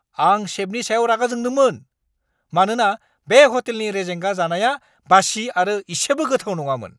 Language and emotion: Bodo, angry